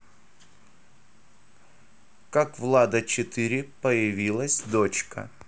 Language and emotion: Russian, neutral